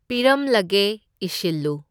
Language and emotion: Manipuri, neutral